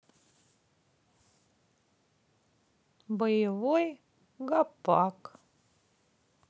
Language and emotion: Russian, sad